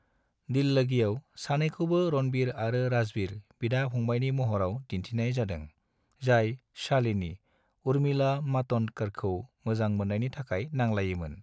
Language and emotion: Bodo, neutral